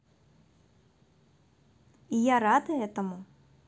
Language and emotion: Russian, positive